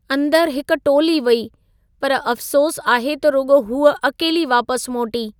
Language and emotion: Sindhi, sad